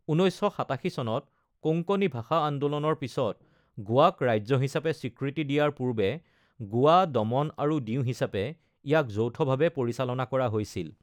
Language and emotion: Assamese, neutral